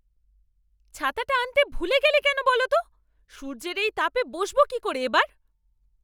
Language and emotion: Bengali, angry